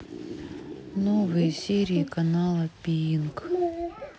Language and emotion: Russian, sad